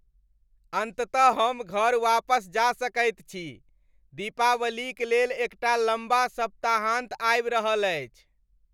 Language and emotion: Maithili, happy